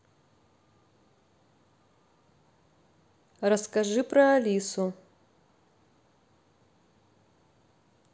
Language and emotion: Russian, neutral